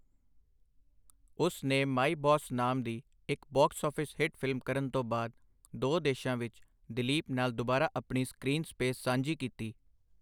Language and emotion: Punjabi, neutral